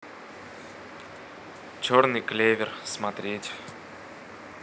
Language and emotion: Russian, neutral